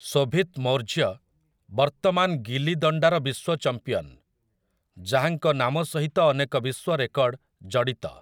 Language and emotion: Odia, neutral